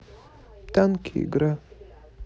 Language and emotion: Russian, neutral